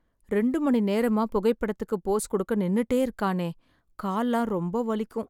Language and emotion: Tamil, sad